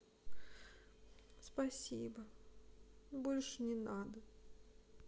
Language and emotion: Russian, sad